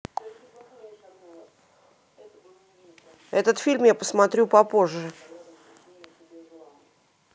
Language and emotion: Russian, neutral